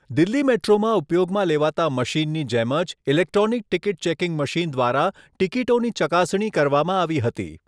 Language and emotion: Gujarati, neutral